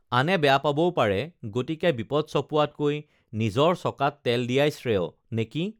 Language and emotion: Assamese, neutral